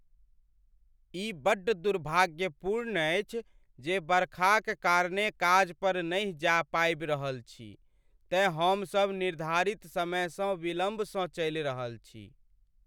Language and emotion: Maithili, sad